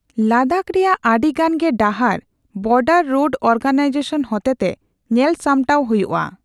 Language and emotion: Santali, neutral